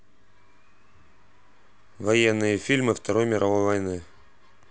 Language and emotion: Russian, neutral